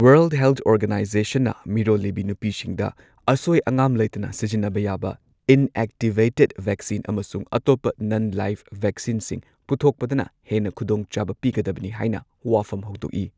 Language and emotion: Manipuri, neutral